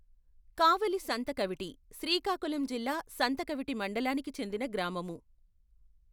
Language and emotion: Telugu, neutral